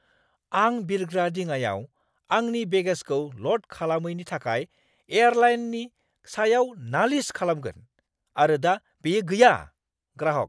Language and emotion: Bodo, angry